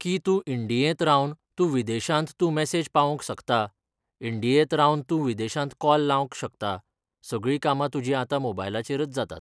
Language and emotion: Goan Konkani, neutral